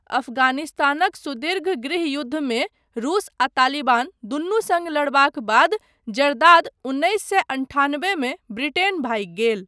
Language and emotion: Maithili, neutral